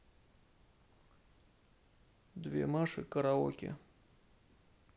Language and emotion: Russian, sad